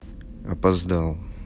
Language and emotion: Russian, sad